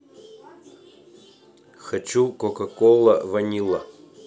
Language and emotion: Russian, neutral